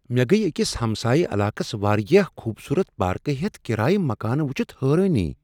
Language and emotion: Kashmiri, surprised